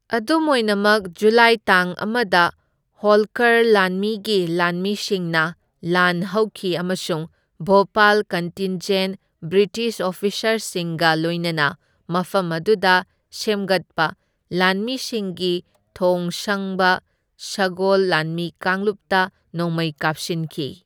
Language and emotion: Manipuri, neutral